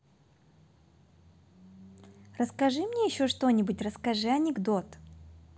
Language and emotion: Russian, positive